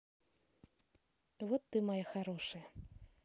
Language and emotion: Russian, neutral